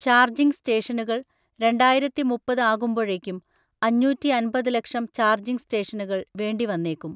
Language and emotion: Malayalam, neutral